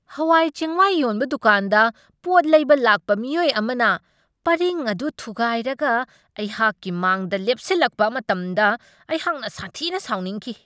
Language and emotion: Manipuri, angry